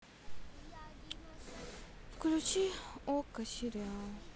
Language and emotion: Russian, sad